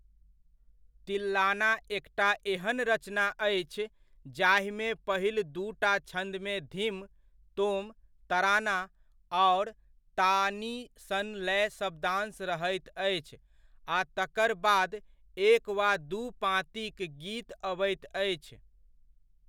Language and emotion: Maithili, neutral